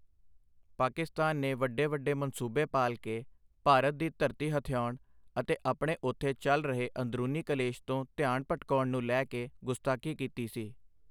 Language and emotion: Punjabi, neutral